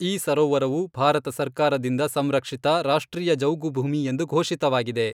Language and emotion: Kannada, neutral